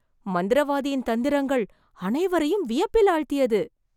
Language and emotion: Tamil, surprised